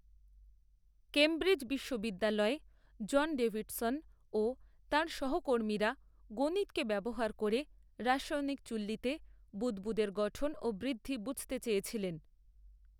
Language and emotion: Bengali, neutral